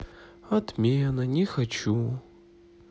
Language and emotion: Russian, sad